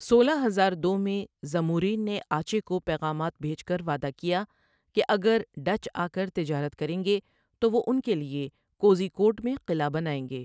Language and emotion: Urdu, neutral